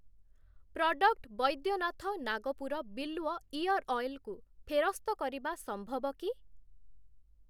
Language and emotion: Odia, neutral